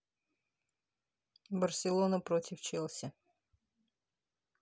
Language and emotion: Russian, neutral